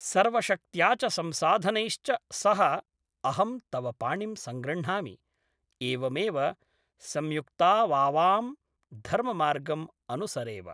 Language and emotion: Sanskrit, neutral